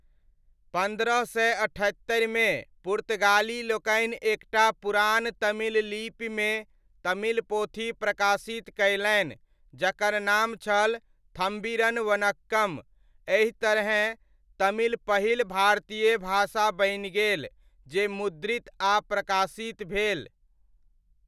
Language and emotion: Maithili, neutral